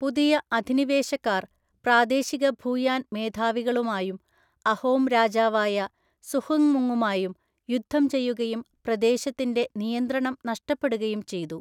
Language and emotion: Malayalam, neutral